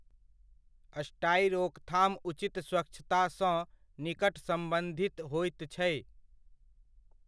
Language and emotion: Maithili, neutral